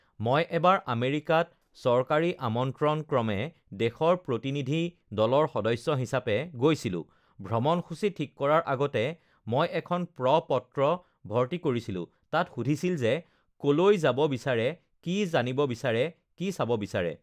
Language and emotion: Assamese, neutral